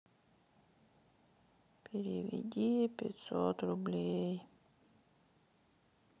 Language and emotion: Russian, sad